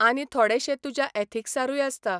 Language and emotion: Goan Konkani, neutral